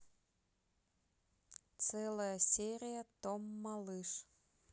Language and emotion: Russian, neutral